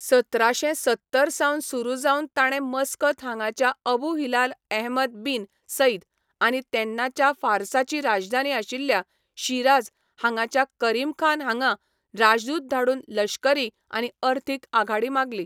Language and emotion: Goan Konkani, neutral